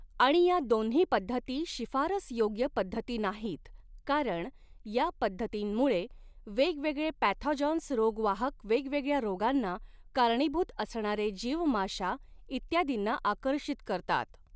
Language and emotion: Marathi, neutral